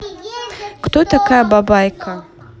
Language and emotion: Russian, neutral